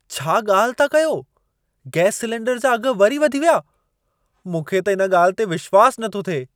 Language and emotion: Sindhi, surprised